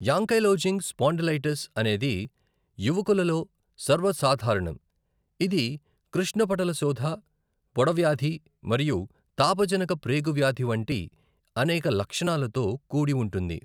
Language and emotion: Telugu, neutral